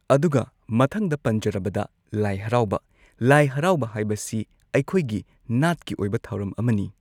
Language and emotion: Manipuri, neutral